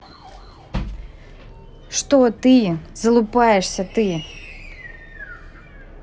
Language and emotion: Russian, angry